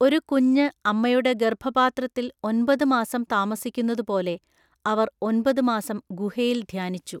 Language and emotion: Malayalam, neutral